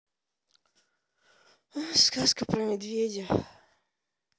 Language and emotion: Russian, sad